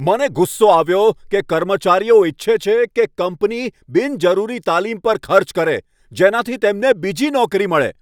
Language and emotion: Gujarati, angry